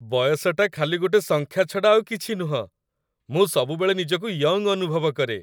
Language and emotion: Odia, happy